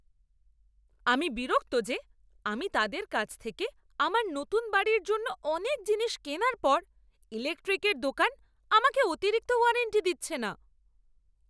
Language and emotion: Bengali, angry